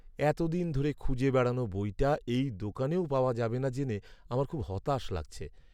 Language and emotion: Bengali, sad